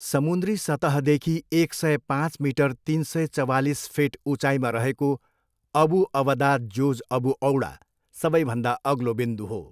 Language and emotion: Nepali, neutral